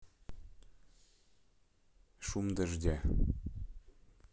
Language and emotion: Russian, neutral